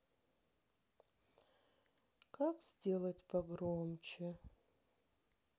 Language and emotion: Russian, sad